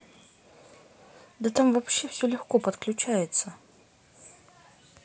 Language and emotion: Russian, neutral